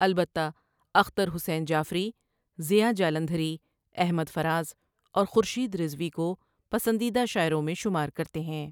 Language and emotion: Urdu, neutral